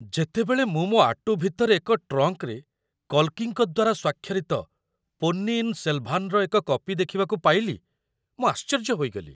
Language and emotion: Odia, surprised